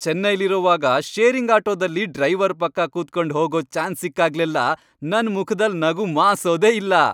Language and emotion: Kannada, happy